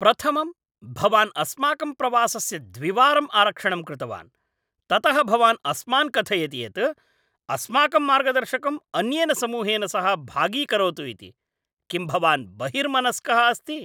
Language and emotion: Sanskrit, angry